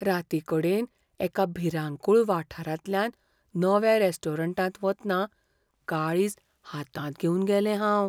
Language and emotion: Goan Konkani, fearful